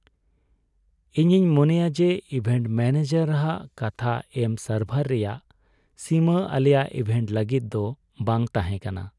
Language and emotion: Santali, sad